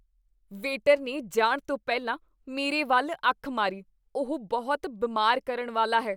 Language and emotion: Punjabi, disgusted